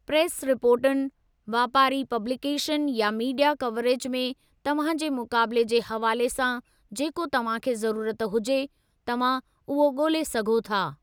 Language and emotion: Sindhi, neutral